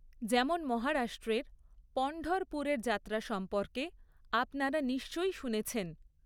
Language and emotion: Bengali, neutral